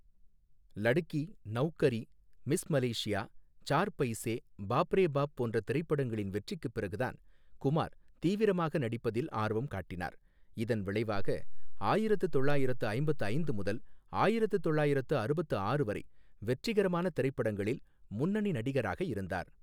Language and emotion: Tamil, neutral